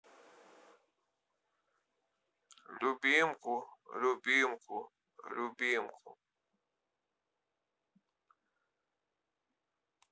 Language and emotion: Russian, neutral